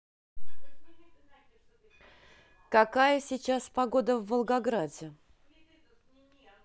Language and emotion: Russian, neutral